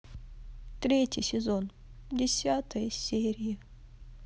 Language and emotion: Russian, sad